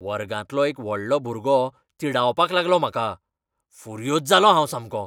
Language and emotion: Goan Konkani, angry